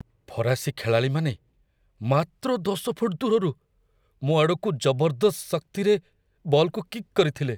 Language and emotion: Odia, fearful